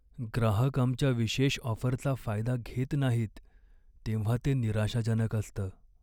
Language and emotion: Marathi, sad